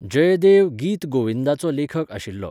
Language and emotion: Goan Konkani, neutral